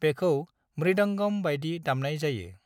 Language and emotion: Bodo, neutral